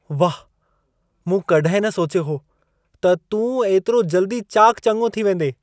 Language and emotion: Sindhi, surprised